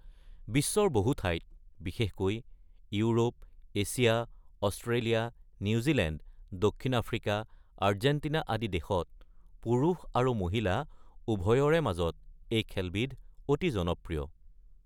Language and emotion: Assamese, neutral